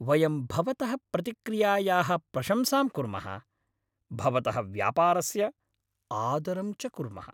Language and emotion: Sanskrit, happy